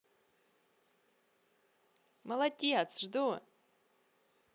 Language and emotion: Russian, positive